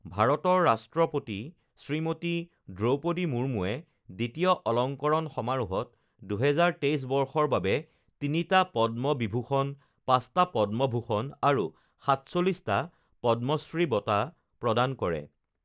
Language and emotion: Assamese, neutral